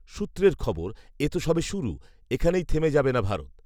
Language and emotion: Bengali, neutral